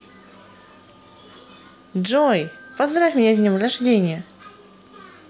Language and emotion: Russian, positive